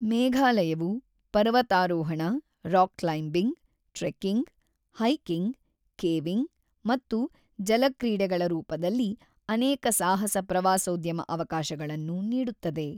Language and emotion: Kannada, neutral